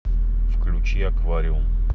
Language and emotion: Russian, neutral